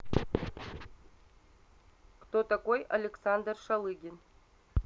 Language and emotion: Russian, neutral